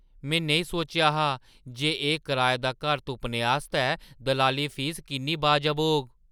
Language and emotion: Dogri, surprised